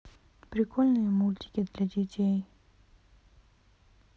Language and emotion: Russian, sad